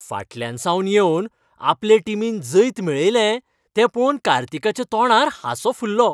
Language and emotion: Goan Konkani, happy